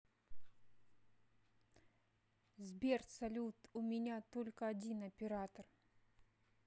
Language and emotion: Russian, neutral